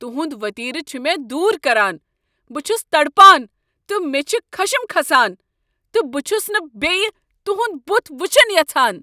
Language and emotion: Kashmiri, angry